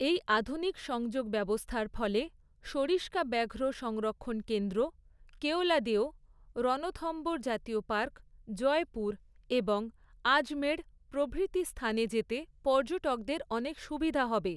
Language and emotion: Bengali, neutral